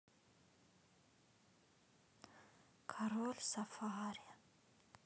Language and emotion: Russian, sad